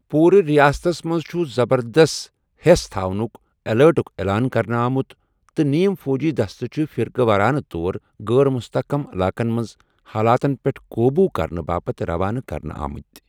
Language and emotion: Kashmiri, neutral